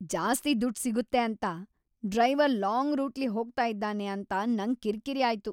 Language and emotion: Kannada, angry